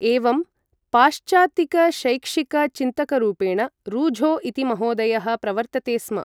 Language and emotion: Sanskrit, neutral